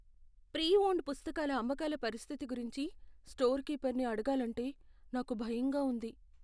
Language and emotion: Telugu, fearful